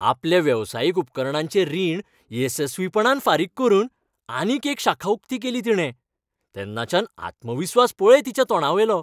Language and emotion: Goan Konkani, happy